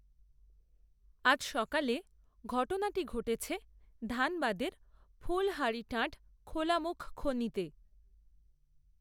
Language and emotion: Bengali, neutral